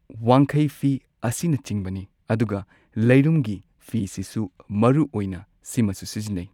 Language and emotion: Manipuri, neutral